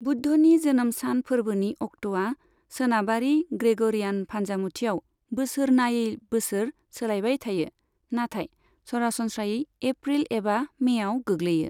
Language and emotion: Bodo, neutral